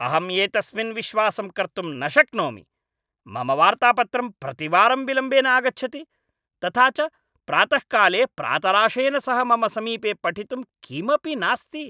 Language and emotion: Sanskrit, angry